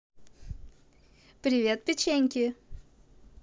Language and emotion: Russian, positive